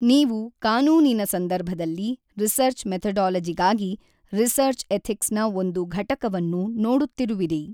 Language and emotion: Kannada, neutral